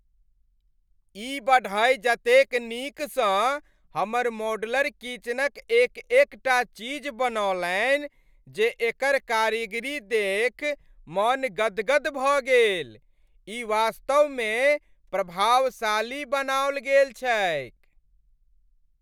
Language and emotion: Maithili, happy